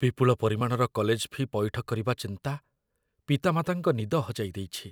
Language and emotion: Odia, fearful